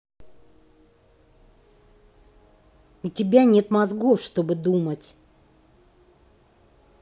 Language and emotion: Russian, angry